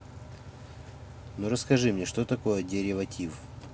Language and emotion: Russian, neutral